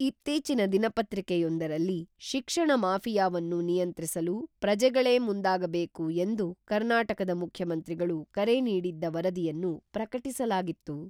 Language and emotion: Kannada, neutral